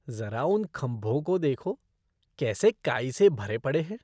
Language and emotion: Hindi, disgusted